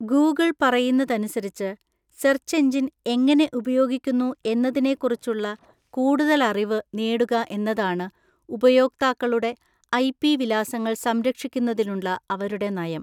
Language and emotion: Malayalam, neutral